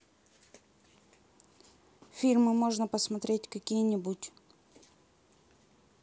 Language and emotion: Russian, neutral